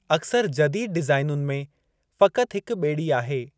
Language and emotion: Sindhi, neutral